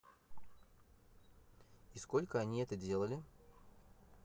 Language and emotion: Russian, neutral